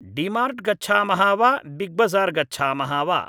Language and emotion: Sanskrit, neutral